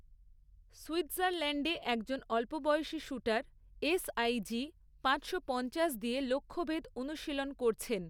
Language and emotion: Bengali, neutral